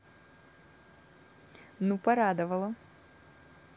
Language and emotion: Russian, positive